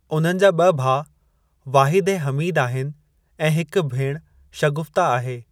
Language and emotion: Sindhi, neutral